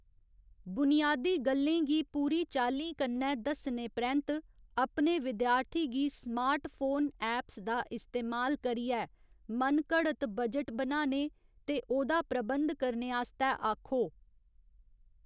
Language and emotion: Dogri, neutral